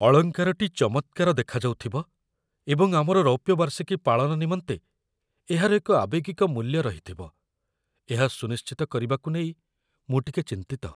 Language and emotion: Odia, fearful